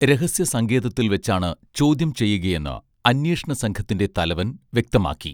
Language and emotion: Malayalam, neutral